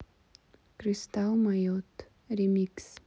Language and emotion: Russian, neutral